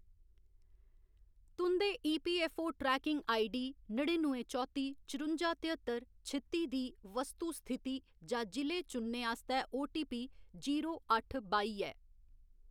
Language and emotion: Dogri, neutral